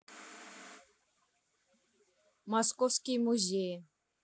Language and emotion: Russian, neutral